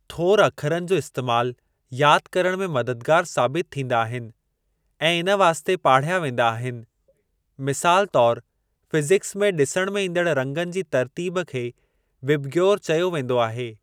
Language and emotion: Sindhi, neutral